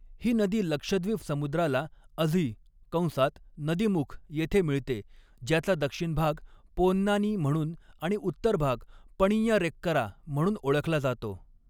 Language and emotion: Marathi, neutral